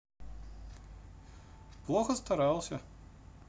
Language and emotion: Russian, neutral